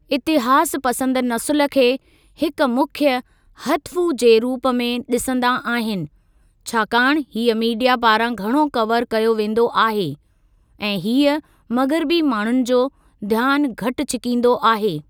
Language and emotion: Sindhi, neutral